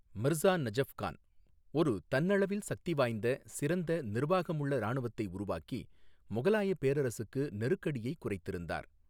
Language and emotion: Tamil, neutral